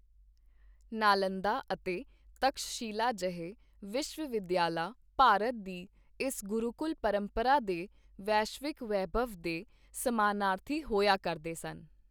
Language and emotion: Punjabi, neutral